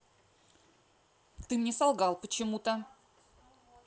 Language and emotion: Russian, angry